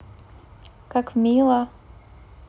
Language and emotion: Russian, positive